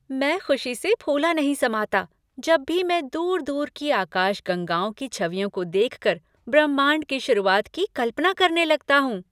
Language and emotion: Hindi, happy